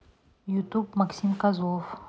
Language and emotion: Russian, neutral